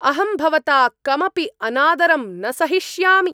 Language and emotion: Sanskrit, angry